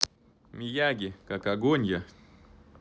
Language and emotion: Russian, neutral